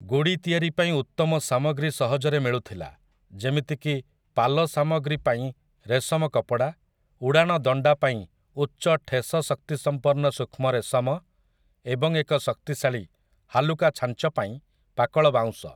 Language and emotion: Odia, neutral